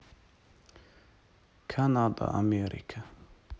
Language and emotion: Russian, neutral